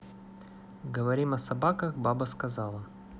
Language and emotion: Russian, neutral